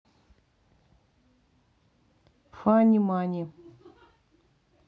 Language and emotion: Russian, neutral